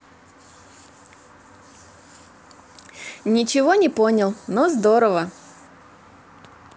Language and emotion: Russian, positive